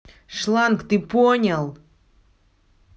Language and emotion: Russian, angry